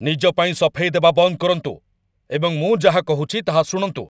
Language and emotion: Odia, angry